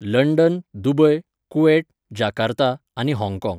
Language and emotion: Goan Konkani, neutral